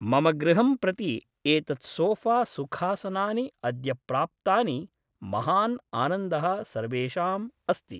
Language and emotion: Sanskrit, neutral